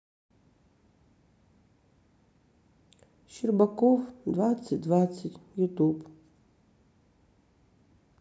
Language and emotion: Russian, sad